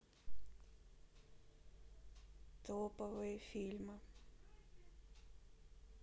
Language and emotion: Russian, sad